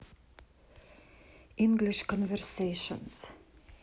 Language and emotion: Russian, neutral